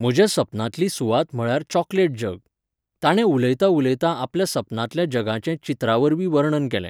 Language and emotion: Goan Konkani, neutral